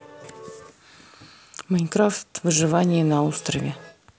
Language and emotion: Russian, neutral